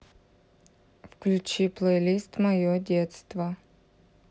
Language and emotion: Russian, neutral